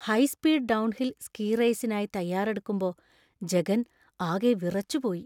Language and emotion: Malayalam, fearful